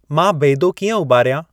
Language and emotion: Sindhi, neutral